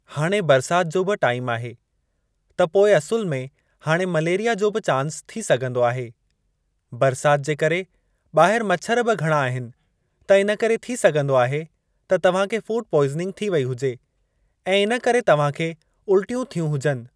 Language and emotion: Sindhi, neutral